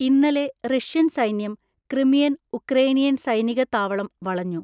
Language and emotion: Malayalam, neutral